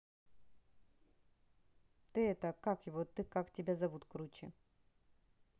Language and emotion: Russian, neutral